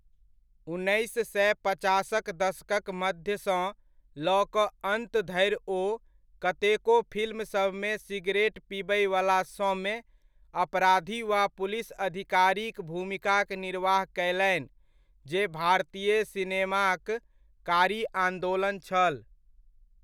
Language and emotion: Maithili, neutral